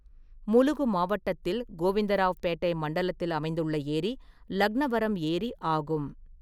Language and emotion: Tamil, neutral